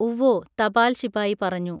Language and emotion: Malayalam, neutral